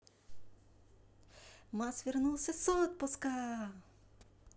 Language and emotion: Russian, positive